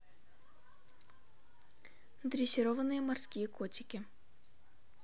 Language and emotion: Russian, neutral